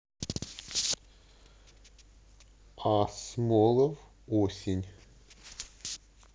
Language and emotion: Russian, neutral